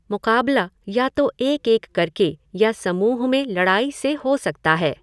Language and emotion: Hindi, neutral